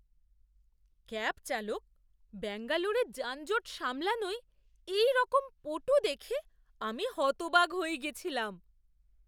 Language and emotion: Bengali, surprised